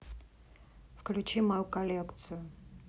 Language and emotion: Russian, neutral